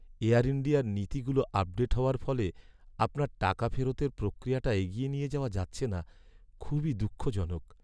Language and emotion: Bengali, sad